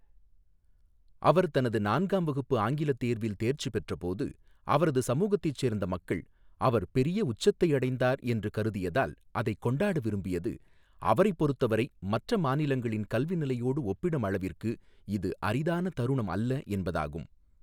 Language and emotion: Tamil, neutral